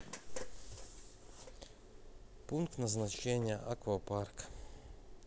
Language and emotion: Russian, neutral